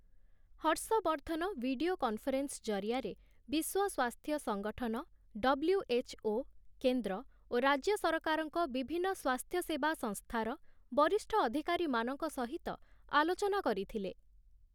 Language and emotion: Odia, neutral